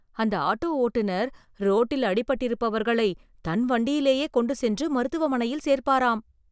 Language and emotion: Tamil, surprised